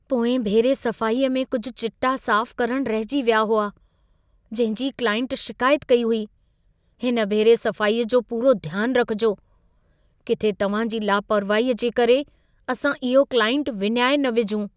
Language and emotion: Sindhi, fearful